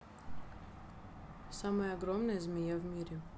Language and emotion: Russian, neutral